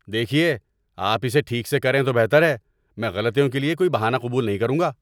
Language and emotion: Urdu, angry